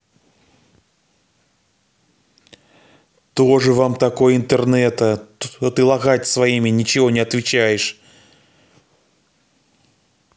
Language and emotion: Russian, angry